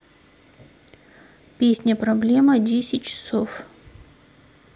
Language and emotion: Russian, neutral